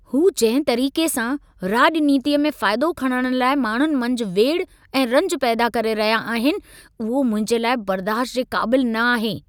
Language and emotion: Sindhi, angry